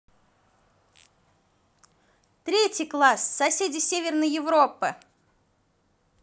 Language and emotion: Russian, positive